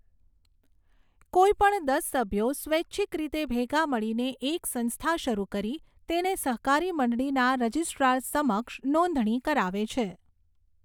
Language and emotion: Gujarati, neutral